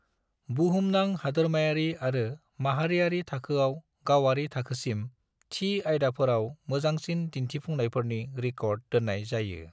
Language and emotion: Bodo, neutral